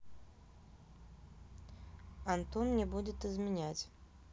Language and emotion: Russian, neutral